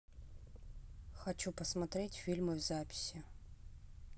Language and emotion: Russian, neutral